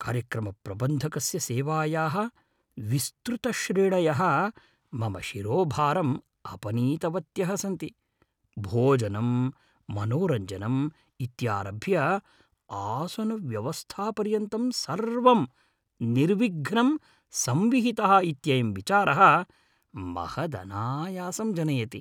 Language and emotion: Sanskrit, happy